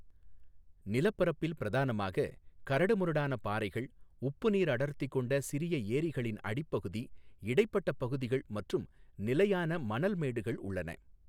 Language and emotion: Tamil, neutral